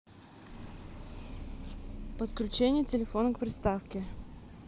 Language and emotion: Russian, neutral